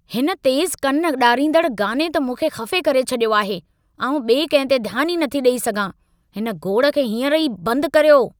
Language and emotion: Sindhi, angry